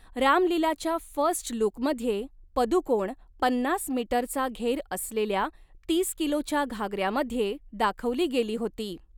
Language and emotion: Marathi, neutral